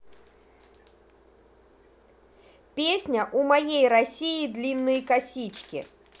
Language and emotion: Russian, positive